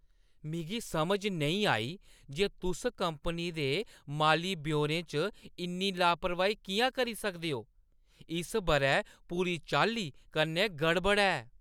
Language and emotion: Dogri, angry